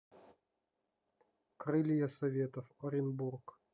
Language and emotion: Russian, neutral